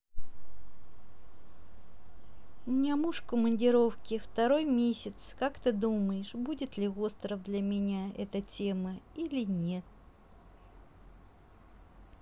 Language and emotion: Russian, neutral